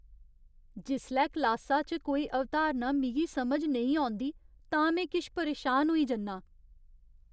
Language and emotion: Dogri, fearful